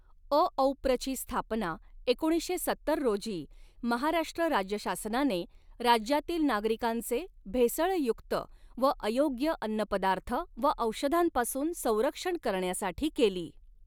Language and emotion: Marathi, neutral